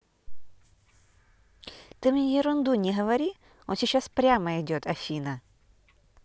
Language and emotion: Russian, neutral